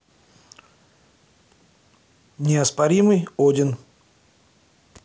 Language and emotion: Russian, neutral